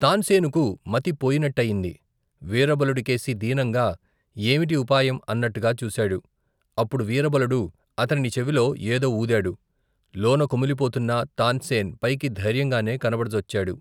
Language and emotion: Telugu, neutral